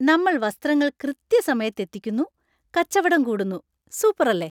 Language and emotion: Malayalam, happy